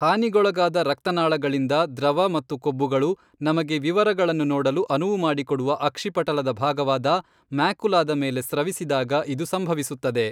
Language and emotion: Kannada, neutral